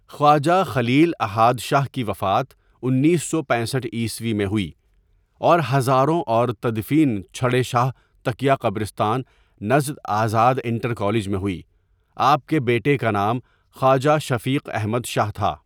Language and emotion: Urdu, neutral